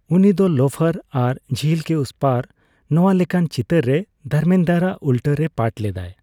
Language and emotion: Santali, neutral